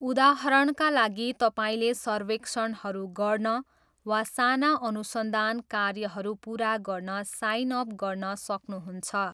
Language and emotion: Nepali, neutral